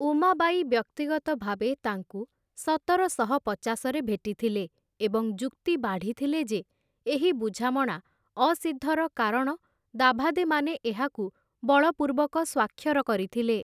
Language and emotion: Odia, neutral